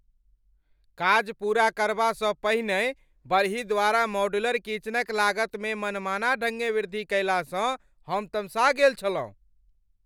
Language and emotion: Maithili, angry